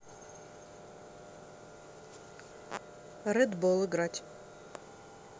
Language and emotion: Russian, neutral